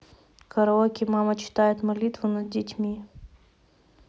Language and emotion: Russian, neutral